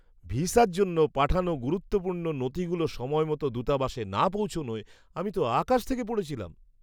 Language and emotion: Bengali, surprised